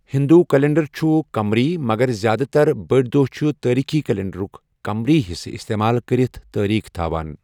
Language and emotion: Kashmiri, neutral